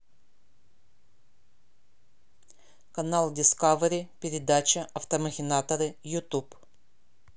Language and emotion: Russian, neutral